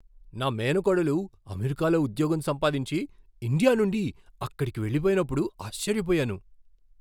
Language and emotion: Telugu, surprised